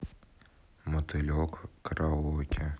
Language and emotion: Russian, neutral